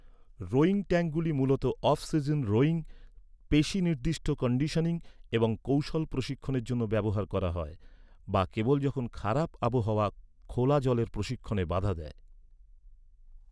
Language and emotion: Bengali, neutral